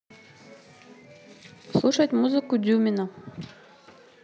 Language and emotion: Russian, neutral